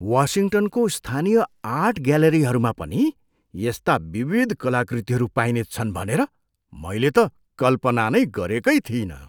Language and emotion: Nepali, surprised